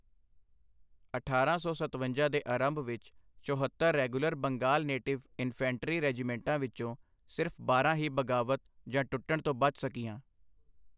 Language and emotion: Punjabi, neutral